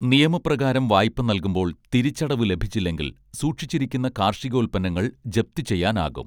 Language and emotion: Malayalam, neutral